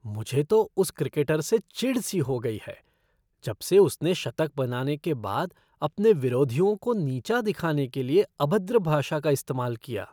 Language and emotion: Hindi, disgusted